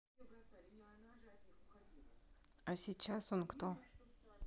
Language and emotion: Russian, neutral